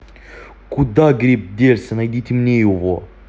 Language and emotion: Russian, angry